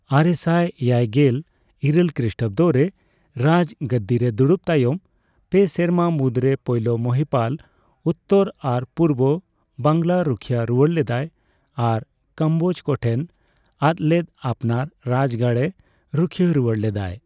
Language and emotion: Santali, neutral